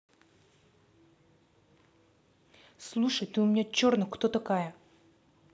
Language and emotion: Russian, angry